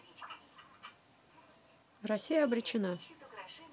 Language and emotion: Russian, neutral